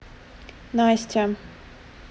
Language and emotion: Russian, neutral